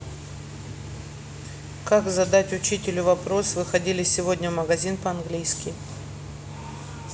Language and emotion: Russian, neutral